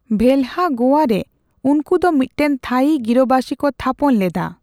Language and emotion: Santali, neutral